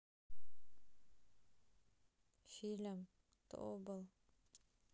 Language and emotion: Russian, sad